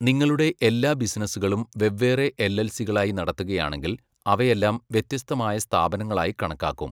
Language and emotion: Malayalam, neutral